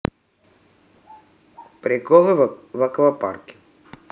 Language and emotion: Russian, neutral